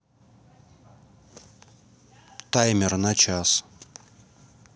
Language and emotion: Russian, neutral